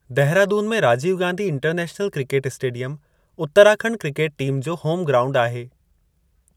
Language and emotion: Sindhi, neutral